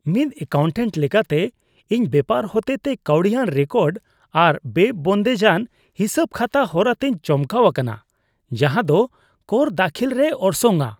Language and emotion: Santali, disgusted